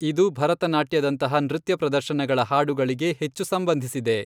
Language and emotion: Kannada, neutral